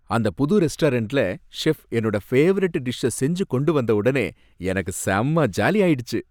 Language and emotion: Tamil, happy